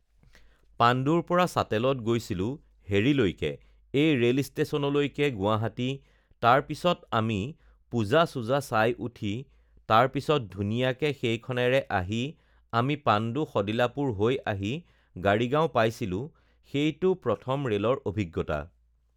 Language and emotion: Assamese, neutral